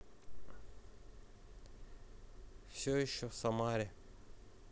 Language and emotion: Russian, neutral